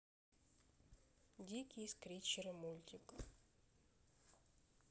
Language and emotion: Russian, neutral